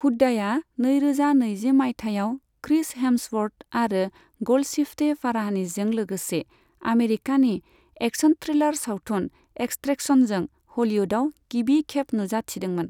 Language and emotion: Bodo, neutral